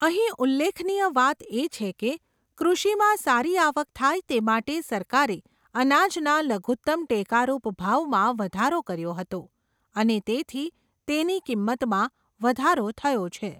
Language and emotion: Gujarati, neutral